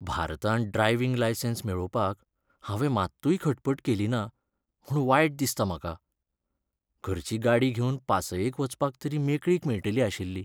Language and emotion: Goan Konkani, sad